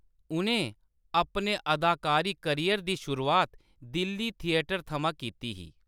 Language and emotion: Dogri, neutral